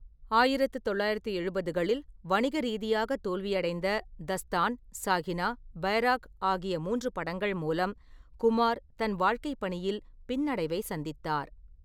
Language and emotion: Tamil, neutral